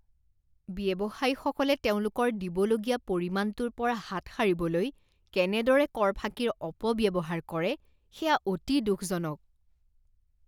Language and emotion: Assamese, disgusted